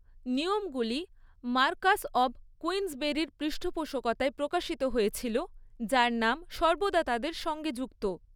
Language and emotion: Bengali, neutral